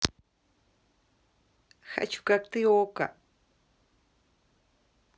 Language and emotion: Russian, positive